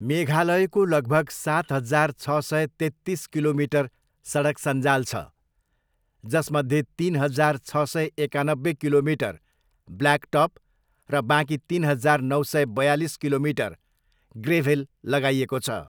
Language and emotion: Nepali, neutral